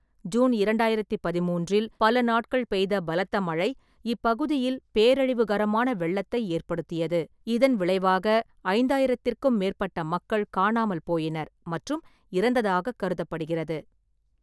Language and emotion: Tamil, neutral